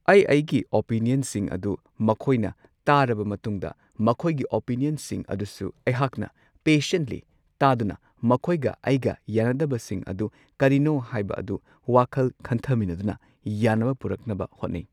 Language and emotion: Manipuri, neutral